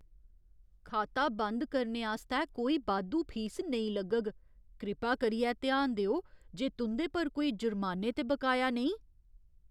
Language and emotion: Dogri, fearful